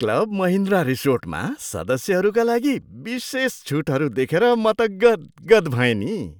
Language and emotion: Nepali, surprised